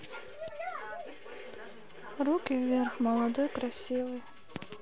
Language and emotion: Russian, sad